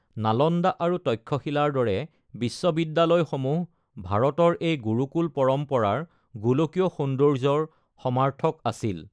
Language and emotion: Assamese, neutral